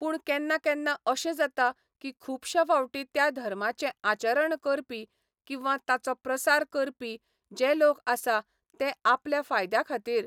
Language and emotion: Goan Konkani, neutral